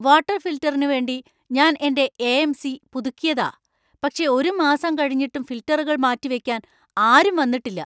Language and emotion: Malayalam, angry